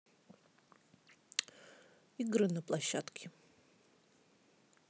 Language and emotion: Russian, neutral